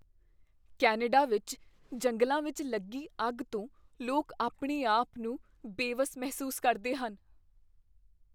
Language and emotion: Punjabi, fearful